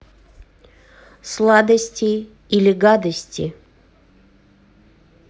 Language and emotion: Russian, neutral